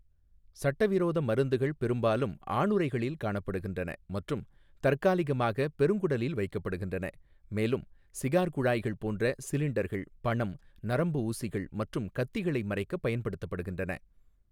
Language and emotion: Tamil, neutral